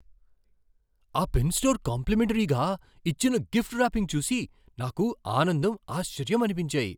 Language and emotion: Telugu, surprised